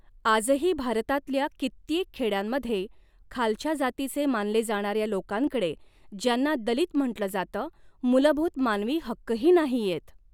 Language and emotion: Marathi, neutral